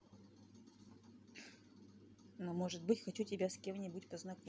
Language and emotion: Russian, neutral